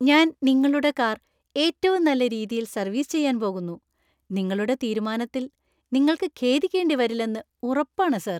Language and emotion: Malayalam, happy